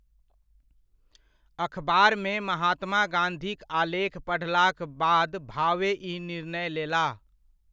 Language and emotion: Maithili, neutral